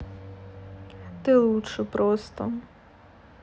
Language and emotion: Russian, neutral